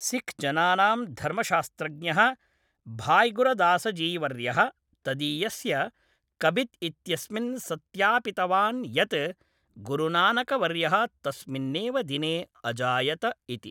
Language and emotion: Sanskrit, neutral